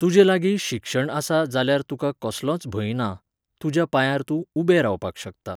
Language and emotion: Goan Konkani, neutral